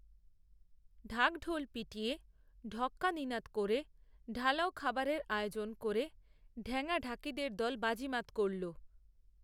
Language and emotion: Bengali, neutral